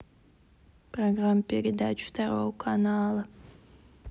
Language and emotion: Russian, neutral